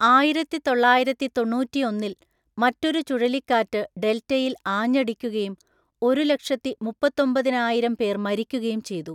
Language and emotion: Malayalam, neutral